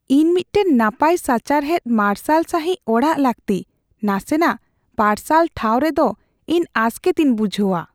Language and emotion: Santali, fearful